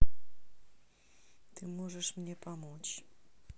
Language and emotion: Russian, neutral